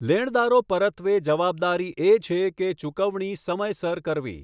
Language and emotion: Gujarati, neutral